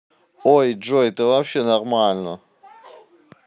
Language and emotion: Russian, neutral